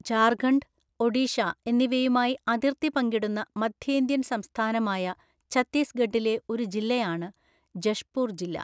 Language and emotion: Malayalam, neutral